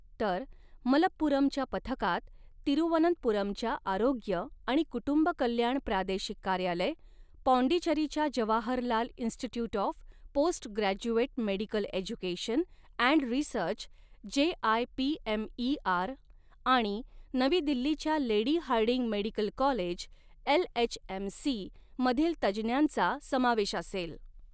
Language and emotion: Marathi, neutral